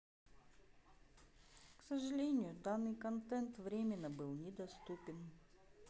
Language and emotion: Russian, sad